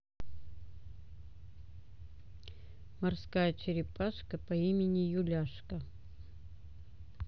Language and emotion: Russian, neutral